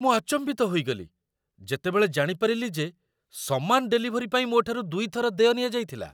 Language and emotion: Odia, surprised